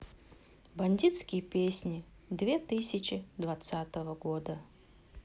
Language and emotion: Russian, sad